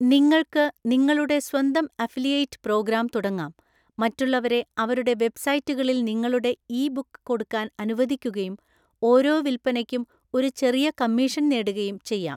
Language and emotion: Malayalam, neutral